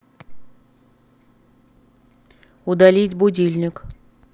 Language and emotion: Russian, neutral